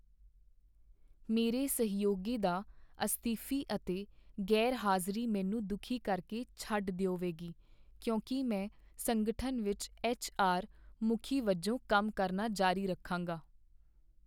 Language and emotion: Punjabi, sad